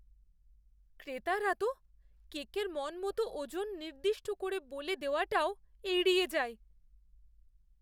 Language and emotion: Bengali, fearful